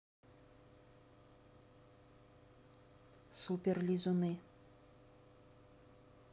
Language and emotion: Russian, neutral